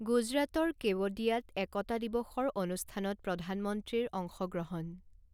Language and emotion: Assamese, neutral